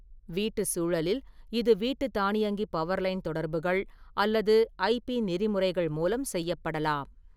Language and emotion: Tamil, neutral